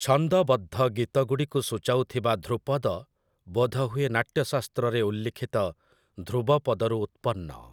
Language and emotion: Odia, neutral